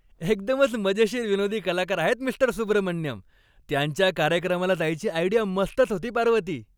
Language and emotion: Marathi, happy